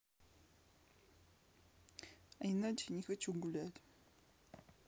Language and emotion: Russian, sad